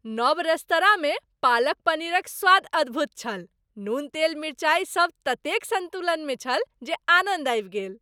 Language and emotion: Maithili, happy